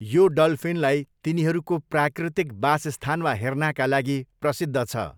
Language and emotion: Nepali, neutral